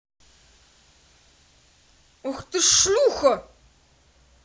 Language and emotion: Russian, angry